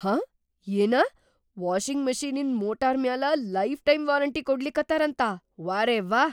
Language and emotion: Kannada, surprised